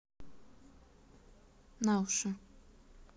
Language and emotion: Russian, neutral